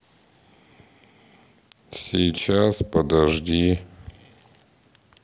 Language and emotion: Russian, neutral